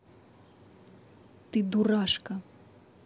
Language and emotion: Russian, neutral